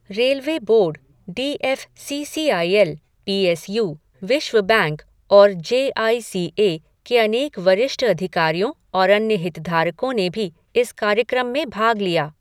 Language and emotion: Hindi, neutral